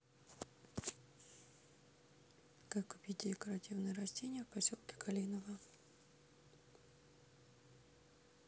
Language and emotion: Russian, neutral